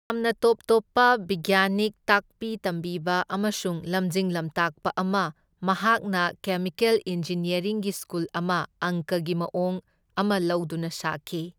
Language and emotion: Manipuri, neutral